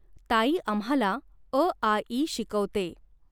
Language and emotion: Marathi, neutral